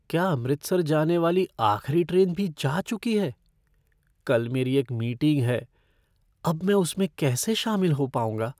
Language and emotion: Hindi, fearful